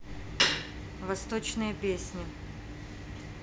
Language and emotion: Russian, neutral